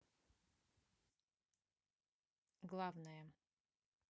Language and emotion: Russian, neutral